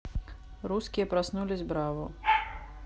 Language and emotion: Russian, neutral